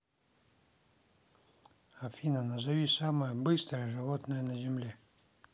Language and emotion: Russian, neutral